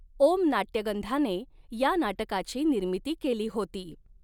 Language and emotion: Marathi, neutral